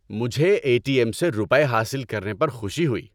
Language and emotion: Urdu, happy